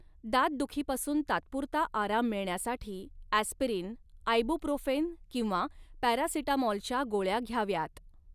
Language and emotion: Marathi, neutral